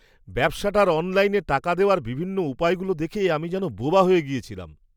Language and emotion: Bengali, surprised